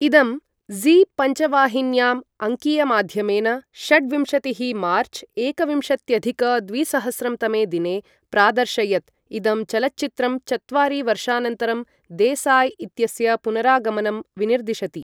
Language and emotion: Sanskrit, neutral